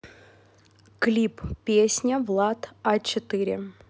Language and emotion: Russian, neutral